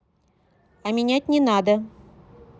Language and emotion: Russian, neutral